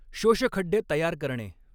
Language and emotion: Marathi, neutral